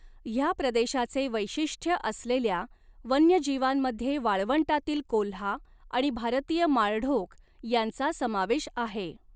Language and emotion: Marathi, neutral